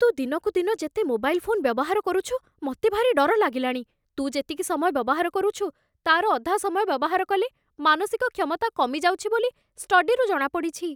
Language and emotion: Odia, fearful